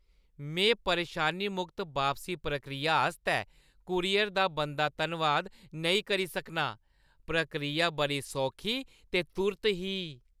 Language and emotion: Dogri, happy